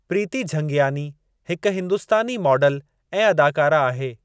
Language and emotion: Sindhi, neutral